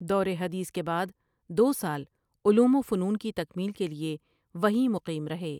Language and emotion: Urdu, neutral